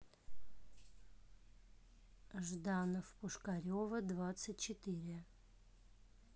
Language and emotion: Russian, neutral